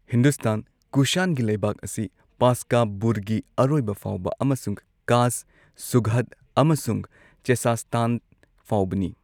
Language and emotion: Manipuri, neutral